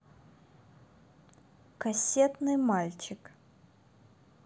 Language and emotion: Russian, neutral